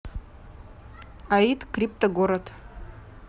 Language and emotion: Russian, neutral